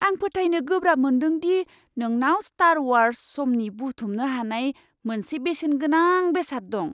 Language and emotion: Bodo, surprised